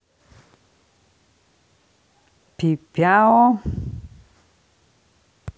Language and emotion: Russian, neutral